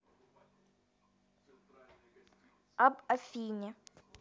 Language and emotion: Russian, neutral